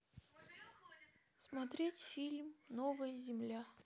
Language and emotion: Russian, sad